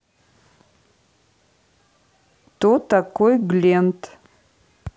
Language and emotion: Russian, neutral